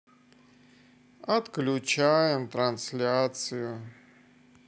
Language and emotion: Russian, sad